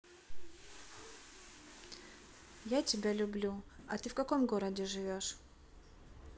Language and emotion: Russian, neutral